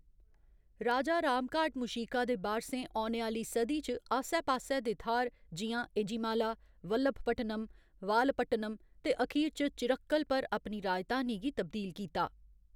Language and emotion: Dogri, neutral